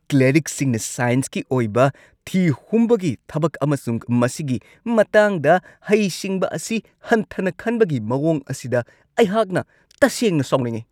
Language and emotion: Manipuri, angry